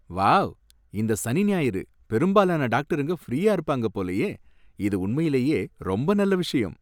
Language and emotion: Tamil, happy